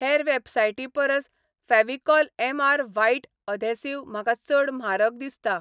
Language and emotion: Goan Konkani, neutral